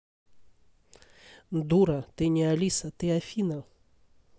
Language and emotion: Russian, neutral